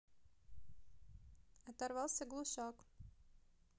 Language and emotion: Russian, neutral